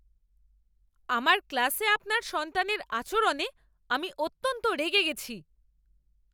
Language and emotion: Bengali, angry